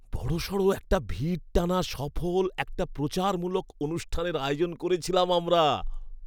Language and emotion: Bengali, happy